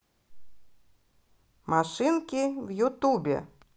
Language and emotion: Russian, positive